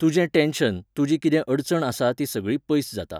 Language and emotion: Goan Konkani, neutral